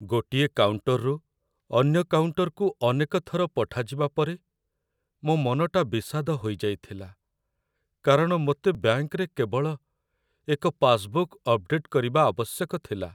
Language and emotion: Odia, sad